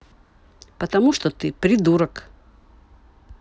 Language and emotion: Russian, neutral